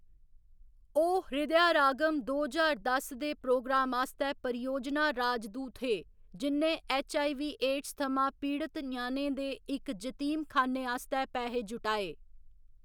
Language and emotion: Dogri, neutral